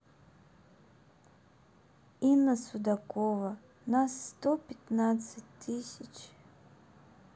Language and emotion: Russian, sad